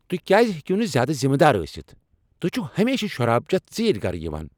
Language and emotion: Kashmiri, angry